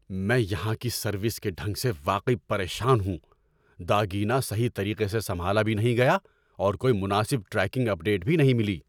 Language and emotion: Urdu, angry